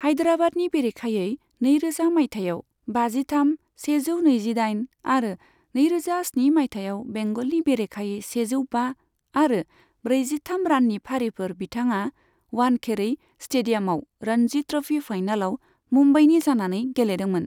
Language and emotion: Bodo, neutral